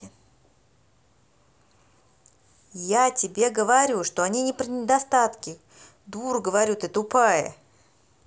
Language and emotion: Russian, angry